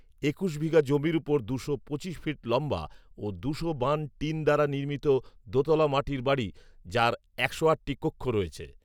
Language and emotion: Bengali, neutral